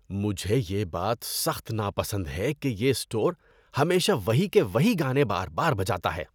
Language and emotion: Urdu, disgusted